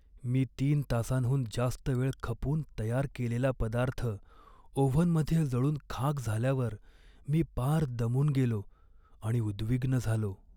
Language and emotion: Marathi, sad